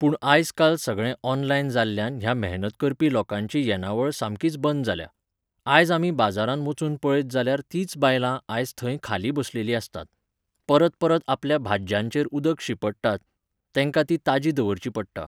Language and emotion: Goan Konkani, neutral